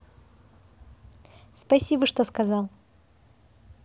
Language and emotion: Russian, positive